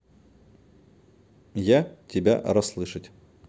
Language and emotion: Russian, neutral